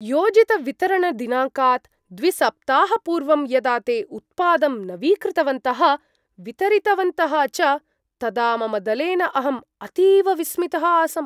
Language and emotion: Sanskrit, surprised